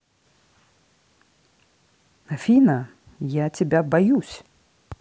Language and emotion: Russian, neutral